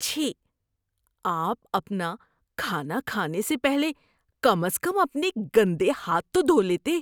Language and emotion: Urdu, disgusted